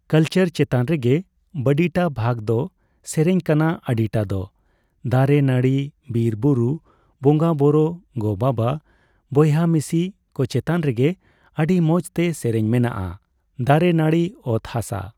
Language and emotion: Santali, neutral